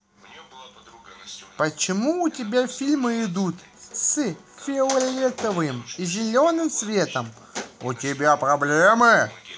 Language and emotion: Russian, positive